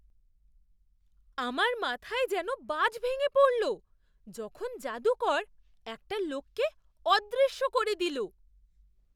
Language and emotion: Bengali, surprised